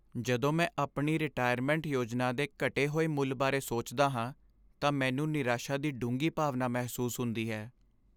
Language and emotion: Punjabi, sad